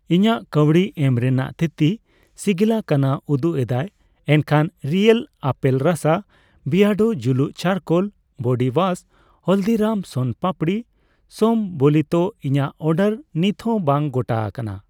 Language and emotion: Santali, neutral